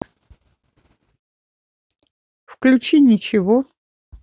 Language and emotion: Russian, neutral